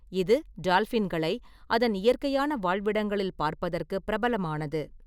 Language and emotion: Tamil, neutral